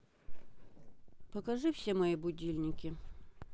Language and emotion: Russian, neutral